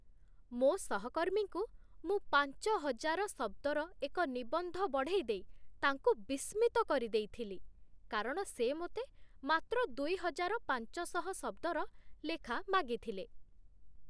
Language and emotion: Odia, surprised